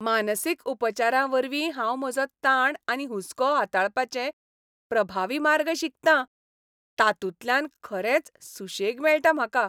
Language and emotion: Goan Konkani, happy